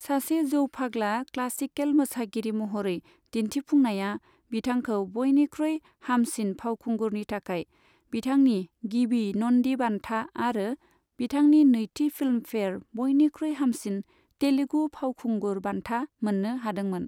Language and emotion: Bodo, neutral